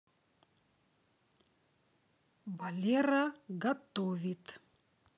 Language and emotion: Russian, neutral